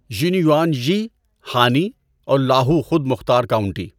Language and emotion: Urdu, neutral